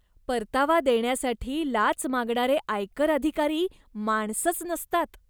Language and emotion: Marathi, disgusted